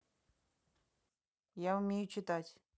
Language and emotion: Russian, neutral